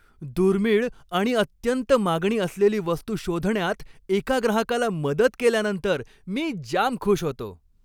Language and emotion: Marathi, happy